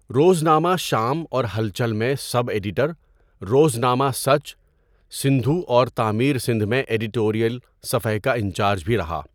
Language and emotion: Urdu, neutral